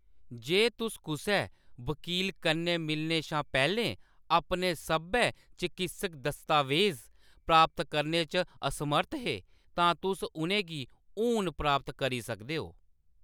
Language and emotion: Dogri, neutral